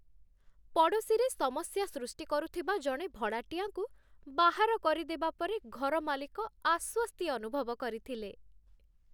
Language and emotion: Odia, happy